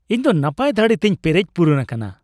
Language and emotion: Santali, happy